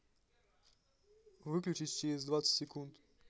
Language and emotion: Russian, neutral